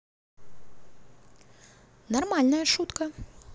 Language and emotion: Russian, neutral